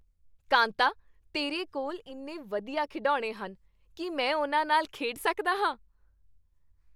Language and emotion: Punjabi, happy